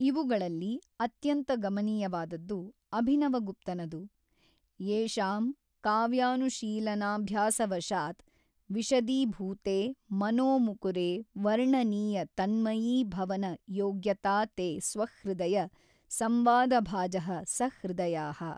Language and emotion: Kannada, neutral